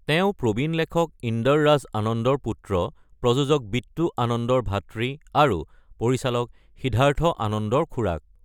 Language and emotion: Assamese, neutral